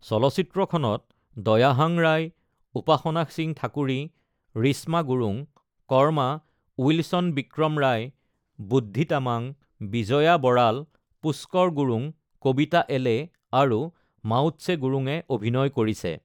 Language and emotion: Assamese, neutral